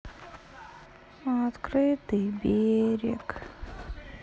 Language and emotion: Russian, sad